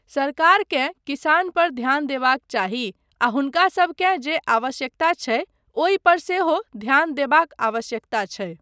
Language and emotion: Maithili, neutral